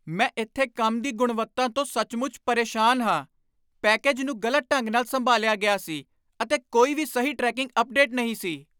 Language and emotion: Punjabi, angry